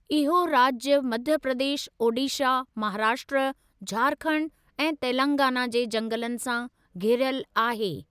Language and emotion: Sindhi, neutral